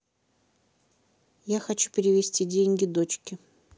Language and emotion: Russian, neutral